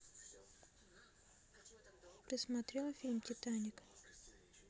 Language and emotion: Russian, neutral